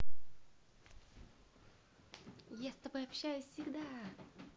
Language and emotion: Russian, positive